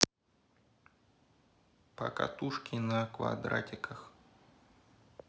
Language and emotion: Russian, neutral